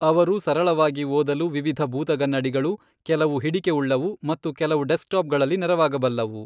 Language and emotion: Kannada, neutral